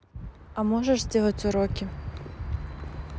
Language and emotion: Russian, neutral